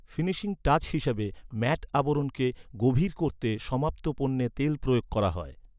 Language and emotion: Bengali, neutral